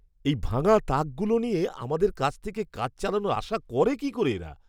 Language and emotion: Bengali, disgusted